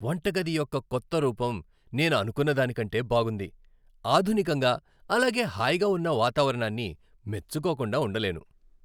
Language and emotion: Telugu, happy